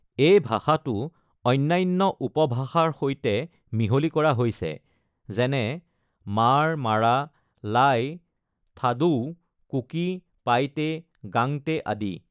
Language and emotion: Assamese, neutral